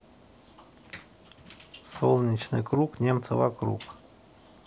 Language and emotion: Russian, neutral